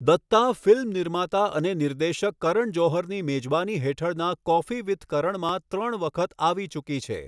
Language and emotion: Gujarati, neutral